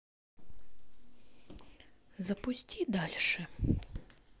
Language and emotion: Russian, neutral